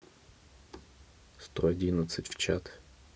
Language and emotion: Russian, neutral